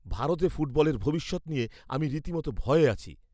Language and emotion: Bengali, fearful